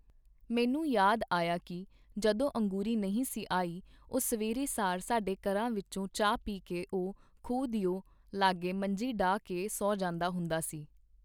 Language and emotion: Punjabi, neutral